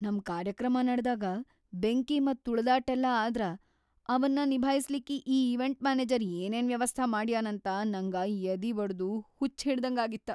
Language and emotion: Kannada, fearful